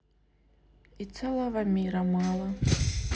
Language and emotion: Russian, sad